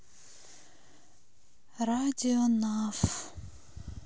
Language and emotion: Russian, sad